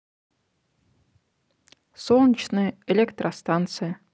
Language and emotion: Russian, neutral